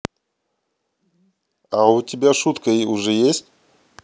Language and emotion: Russian, neutral